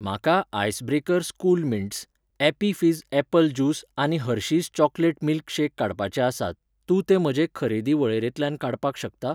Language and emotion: Goan Konkani, neutral